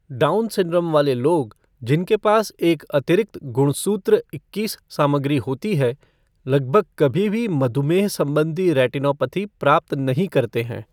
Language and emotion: Hindi, neutral